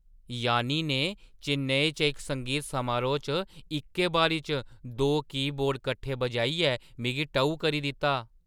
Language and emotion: Dogri, surprised